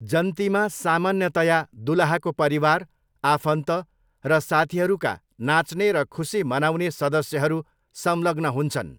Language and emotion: Nepali, neutral